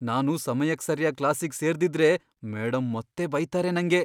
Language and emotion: Kannada, fearful